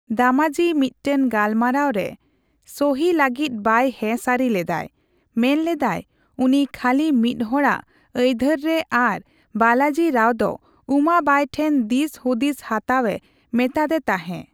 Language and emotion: Santali, neutral